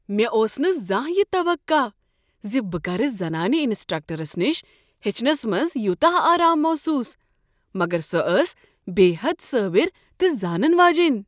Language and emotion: Kashmiri, surprised